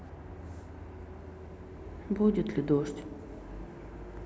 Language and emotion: Russian, sad